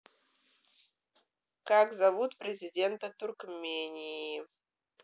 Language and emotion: Russian, neutral